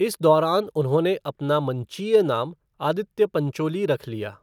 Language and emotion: Hindi, neutral